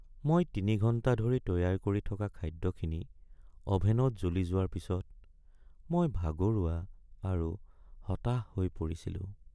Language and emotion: Assamese, sad